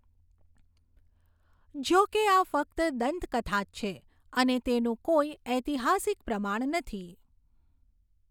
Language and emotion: Gujarati, neutral